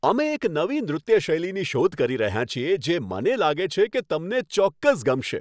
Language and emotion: Gujarati, happy